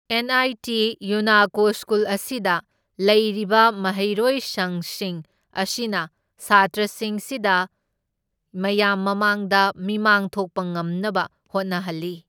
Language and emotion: Manipuri, neutral